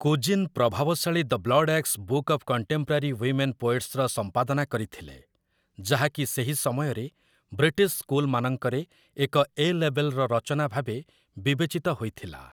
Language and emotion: Odia, neutral